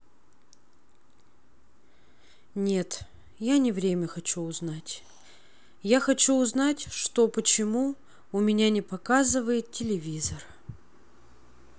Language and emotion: Russian, sad